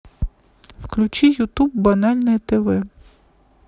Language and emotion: Russian, neutral